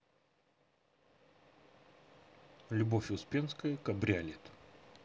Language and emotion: Russian, neutral